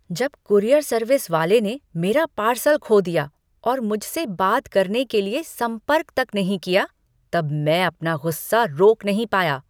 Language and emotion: Hindi, angry